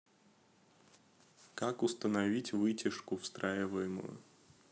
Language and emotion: Russian, neutral